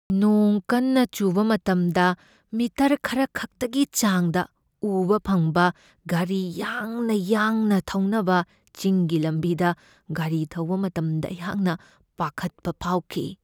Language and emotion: Manipuri, fearful